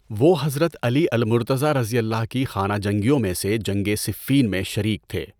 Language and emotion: Urdu, neutral